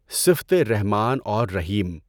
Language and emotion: Urdu, neutral